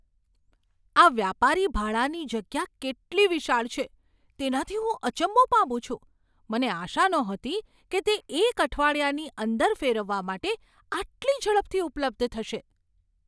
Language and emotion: Gujarati, surprised